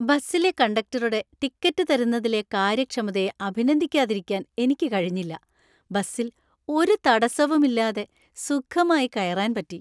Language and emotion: Malayalam, happy